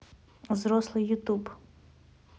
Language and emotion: Russian, neutral